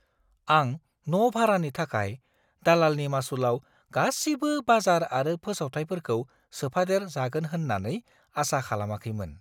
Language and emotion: Bodo, surprised